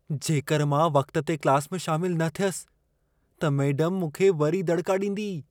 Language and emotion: Sindhi, fearful